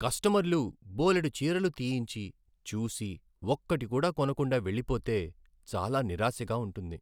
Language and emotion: Telugu, sad